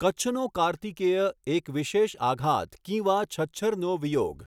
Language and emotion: Gujarati, neutral